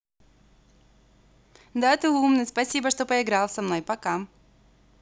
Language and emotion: Russian, positive